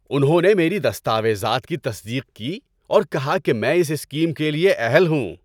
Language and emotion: Urdu, happy